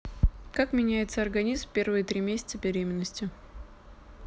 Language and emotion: Russian, neutral